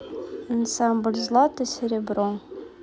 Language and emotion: Russian, neutral